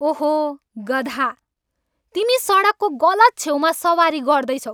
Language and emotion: Nepali, angry